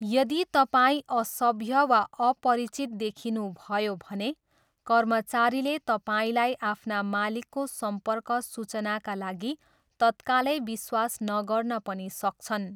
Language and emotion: Nepali, neutral